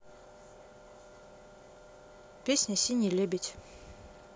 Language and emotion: Russian, neutral